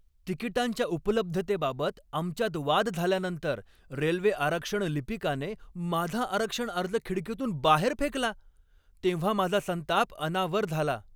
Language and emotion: Marathi, angry